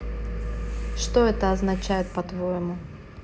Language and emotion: Russian, neutral